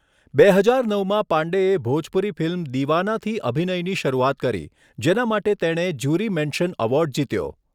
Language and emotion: Gujarati, neutral